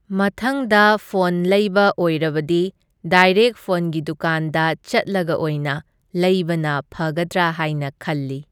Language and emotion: Manipuri, neutral